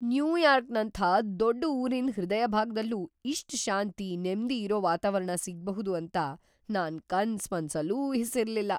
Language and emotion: Kannada, surprised